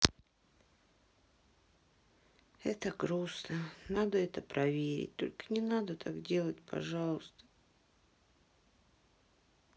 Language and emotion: Russian, sad